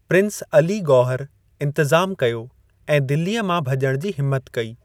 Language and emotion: Sindhi, neutral